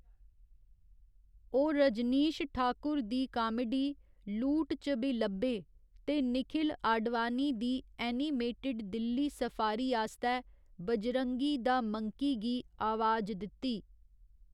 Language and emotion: Dogri, neutral